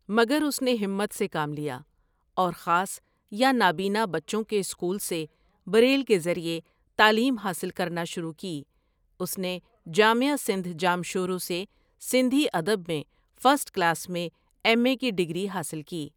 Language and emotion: Urdu, neutral